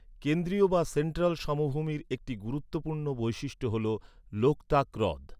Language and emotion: Bengali, neutral